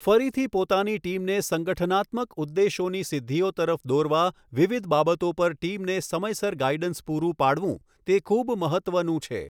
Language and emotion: Gujarati, neutral